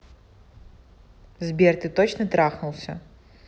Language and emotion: Russian, neutral